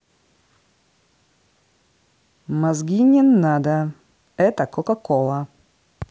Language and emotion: Russian, angry